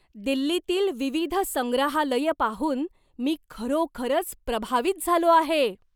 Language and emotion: Marathi, surprised